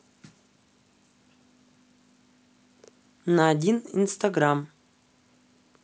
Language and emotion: Russian, neutral